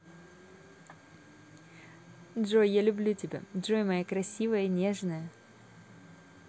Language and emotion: Russian, positive